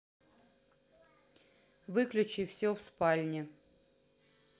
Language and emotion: Russian, neutral